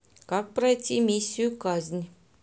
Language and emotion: Russian, neutral